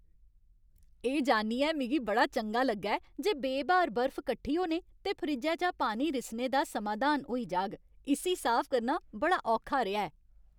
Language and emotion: Dogri, happy